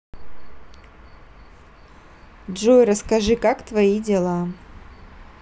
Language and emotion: Russian, neutral